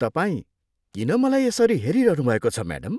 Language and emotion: Nepali, disgusted